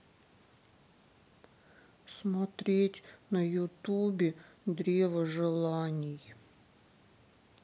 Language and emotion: Russian, sad